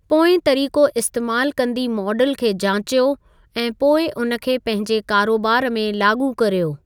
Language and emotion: Sindhi, neutral